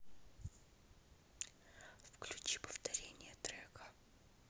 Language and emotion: Russian, neutral